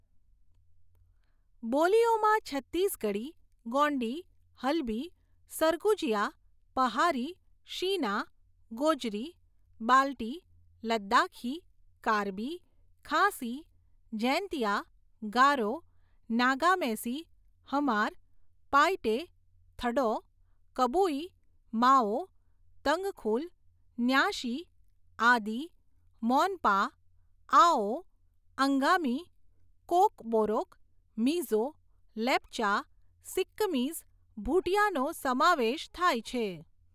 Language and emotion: Gujarati, neutral